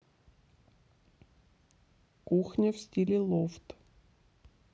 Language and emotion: Russian, neutral